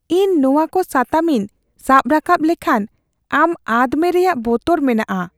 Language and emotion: Santali, fearful